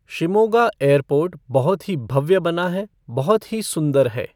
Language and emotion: Hindi, neutral